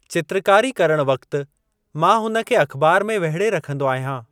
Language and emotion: Sindhi, neutral